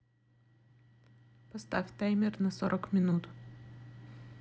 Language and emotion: Russian, neutral